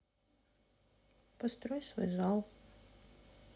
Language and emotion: Russian, sad